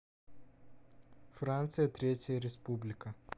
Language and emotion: Russian, neutral